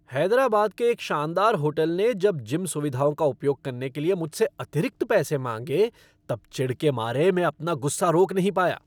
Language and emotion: Hindi, angry